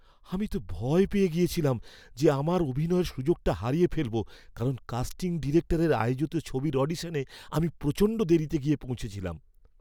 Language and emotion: Bengali, fearful